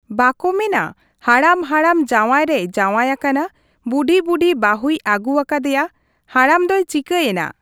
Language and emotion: Santali, neutral